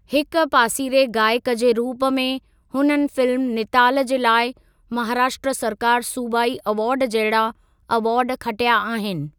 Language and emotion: Sindhi, neutral